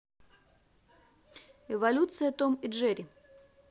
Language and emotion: Russian, positive